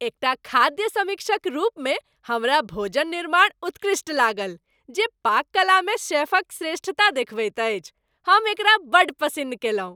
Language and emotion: Maithili, happy